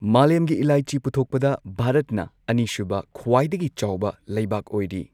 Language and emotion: Manipuri, neutral